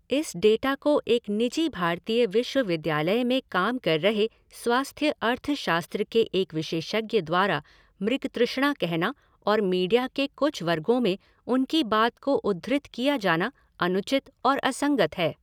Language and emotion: Hindi, neutral